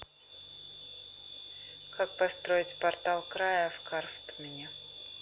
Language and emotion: Russian, neutral